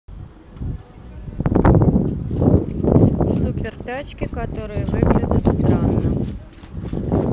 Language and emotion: Russian, neutral